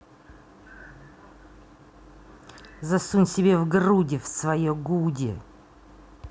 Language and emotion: Russian, angry